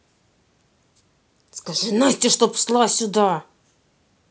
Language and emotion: Russian, angry